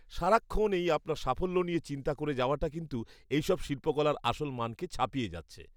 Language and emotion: Bengali, disgusted